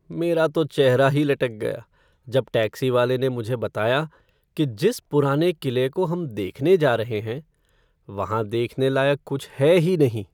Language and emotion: Hindi, sad